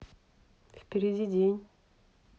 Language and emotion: Russian, neutral